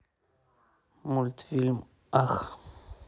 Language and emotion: Russian, neutral